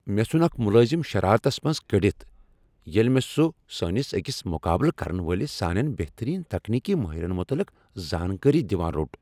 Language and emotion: Kashmiri, angry